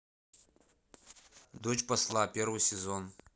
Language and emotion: Russian, neutral